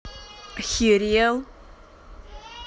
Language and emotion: Russian, angry